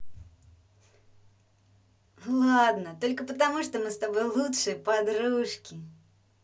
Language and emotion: Russian, positive